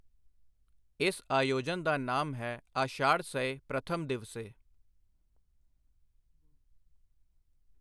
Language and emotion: Punjabi, neutral